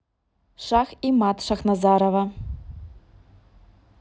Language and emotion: Russian, neutral